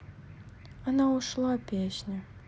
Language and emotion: Russian, sad